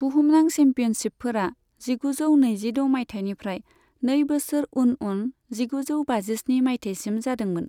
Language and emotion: Bodo, neutral